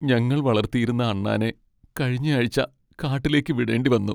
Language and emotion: Malayalam, sad